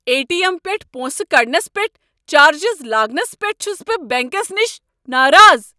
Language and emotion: Kashmiri, angry